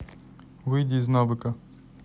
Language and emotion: Russian, neutral